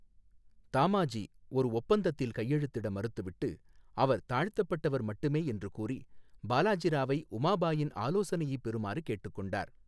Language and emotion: Tamil, neutral